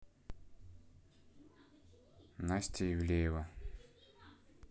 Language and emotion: Russian, neutral